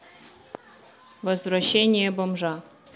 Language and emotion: Russian, neutral